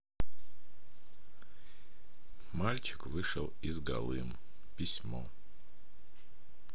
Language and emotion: Russian, neutral